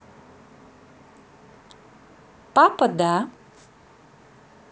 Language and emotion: Russian, positive